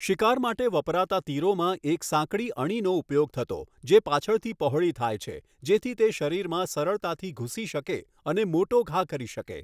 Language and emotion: Gujarati, neutral